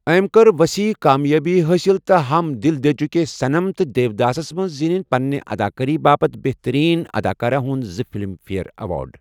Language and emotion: Kashmiri, neutral